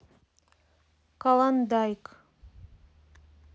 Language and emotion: Russian, neutral